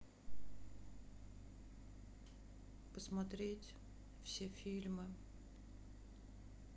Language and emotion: Russian, sad